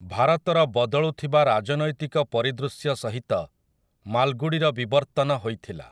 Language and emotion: Odia, neutral